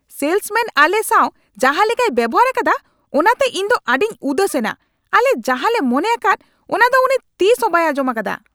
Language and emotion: Santali, angry